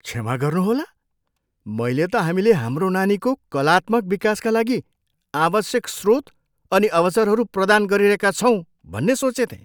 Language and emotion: Nepali, surprised